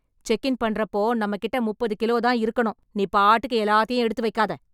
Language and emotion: Tamil, angry